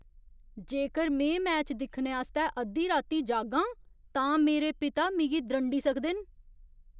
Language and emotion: Dogri, fearful